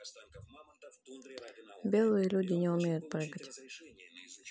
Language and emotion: Russian, neutral